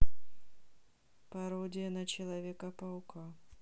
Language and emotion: Russian, neutral